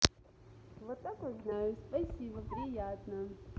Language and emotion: Russian, positive